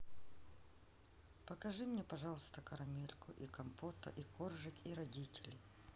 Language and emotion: Russian, neutral